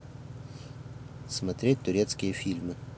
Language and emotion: Russian, neutral